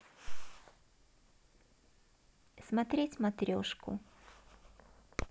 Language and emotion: Russian, neutral